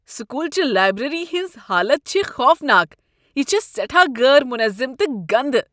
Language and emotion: Kashmiri, disgusted